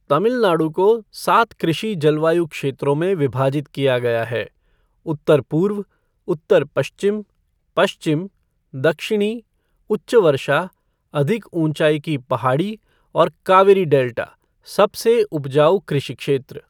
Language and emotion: Hindi, neutral